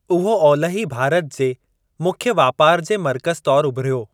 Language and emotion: Sindhi, neutral